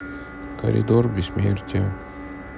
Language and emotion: Russian, sad